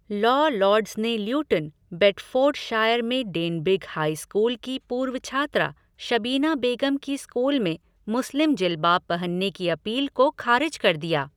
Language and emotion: Hindi, neutral